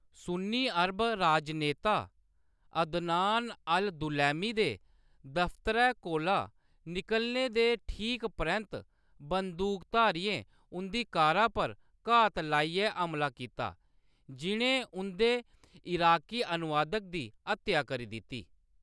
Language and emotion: Dogri, neutral